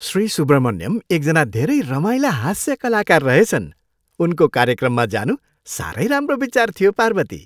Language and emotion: Nepali, happy